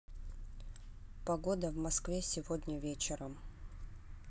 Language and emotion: Russian, neutral